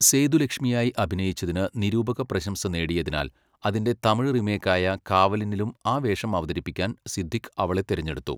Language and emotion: Malayalam, neutral